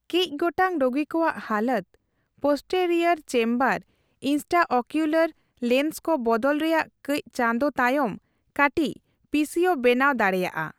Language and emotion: Santali, neutral